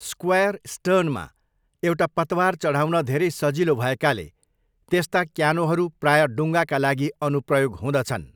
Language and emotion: Nepali, neutral